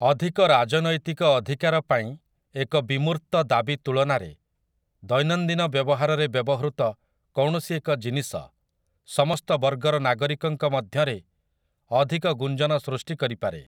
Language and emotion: Odia, neutral